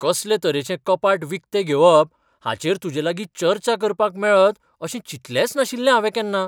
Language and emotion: Goan Konkani, surprised